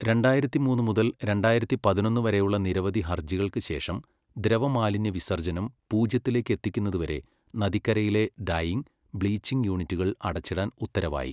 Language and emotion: Malayalam, neutral